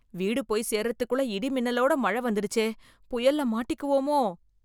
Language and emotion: Tamil, fearful